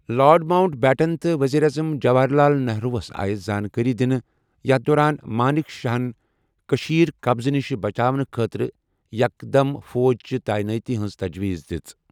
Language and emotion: Kashmiri, neutral